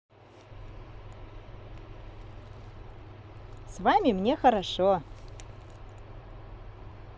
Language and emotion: Russian, positive